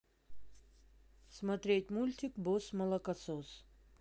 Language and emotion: Russian, neutral